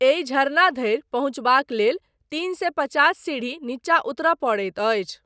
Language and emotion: Maithili, neutral